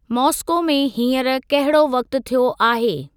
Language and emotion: Sindhi, neutral